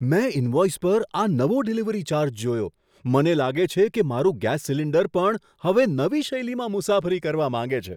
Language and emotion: Gujarati, surprised